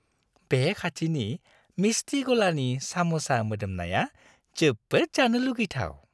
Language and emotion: Bodo, happy